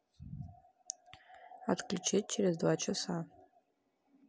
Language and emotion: Russian, neutral